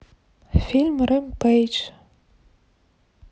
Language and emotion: Russian, neutral